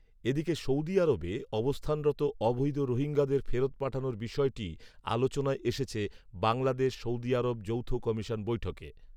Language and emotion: Bengali, neutral